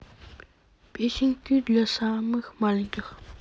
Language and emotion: Russian, neutral